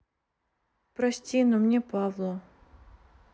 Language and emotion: Russian, sad